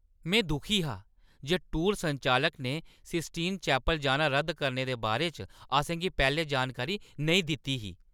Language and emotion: Dogri, angry